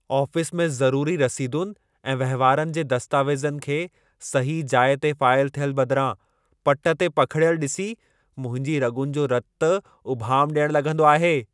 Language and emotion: Sindhi, angry